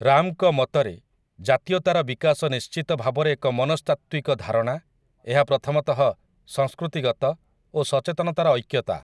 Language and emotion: Odia, neutral